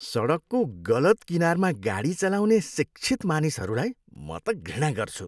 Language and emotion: Nepali, disgusted